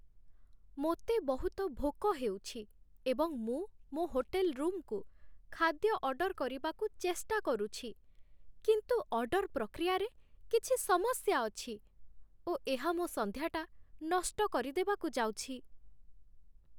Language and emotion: Odia, sad